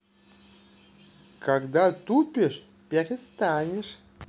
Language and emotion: Russian, positive